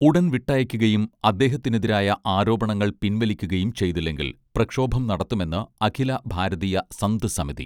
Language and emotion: Malayalam, neutral